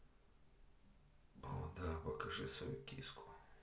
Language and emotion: Russian, neutral